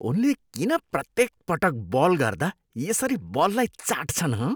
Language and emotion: Nepali, disgusted